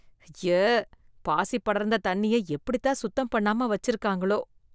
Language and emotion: Tamil, disgusted